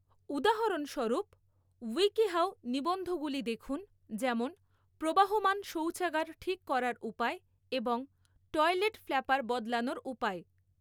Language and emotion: Bengali, neutral